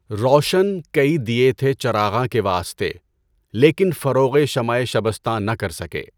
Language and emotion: Urdu, neutral